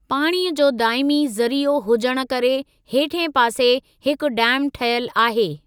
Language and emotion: Sindhi, neutral